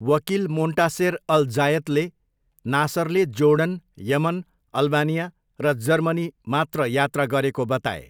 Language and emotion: Nepali, neutral